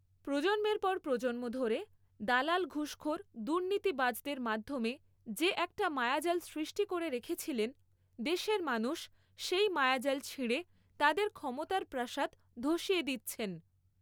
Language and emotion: Bengali, neutral